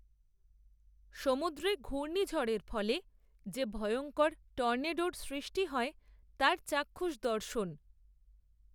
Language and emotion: Bengali, neutral